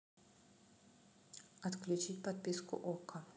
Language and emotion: Russian, neutral